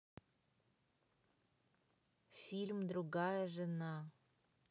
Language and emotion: Russian, neutral